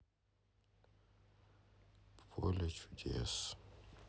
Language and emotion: Russian, sad